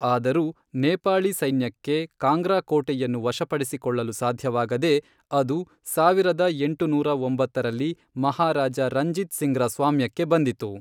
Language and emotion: Kannada, neutral